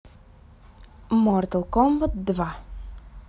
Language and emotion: Russian, neutral